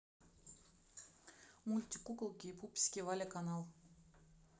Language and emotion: Russian, neutral